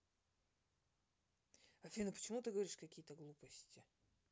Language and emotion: Russian, neutral